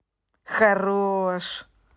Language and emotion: Russian, positive